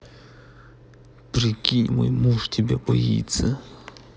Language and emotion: Russian, angry